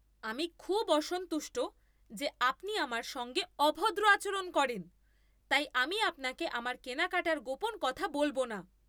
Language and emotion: Bengali, angry